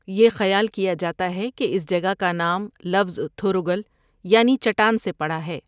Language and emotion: Urdu, neutral